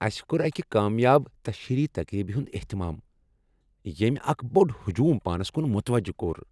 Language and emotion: Kashmiri, happy